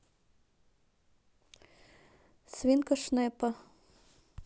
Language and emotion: Russian, neutral